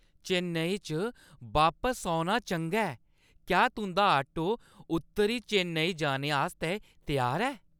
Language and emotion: Dogri, happy